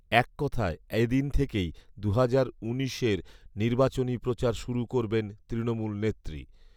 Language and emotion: Bengali, neutral